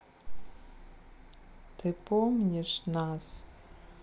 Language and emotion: Russian, sad